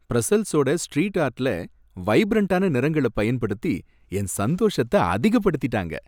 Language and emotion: Tamil, happy